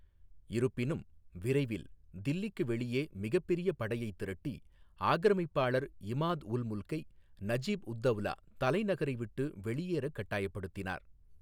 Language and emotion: Tamil, neutral